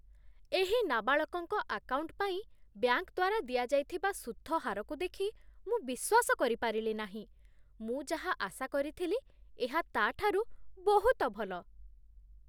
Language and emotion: Odia, surprised